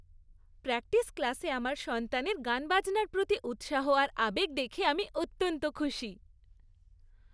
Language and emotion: Bengali, happy